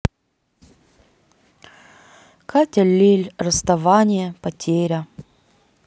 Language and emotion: Russian, sad